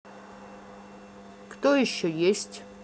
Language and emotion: Russian, neutral